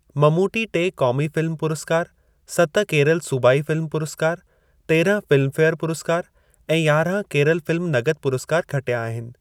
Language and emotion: Sindhi, neutral